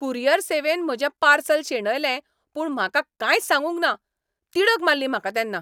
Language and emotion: Goan Konkani, angry